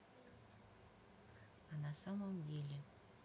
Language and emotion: Russian, neutral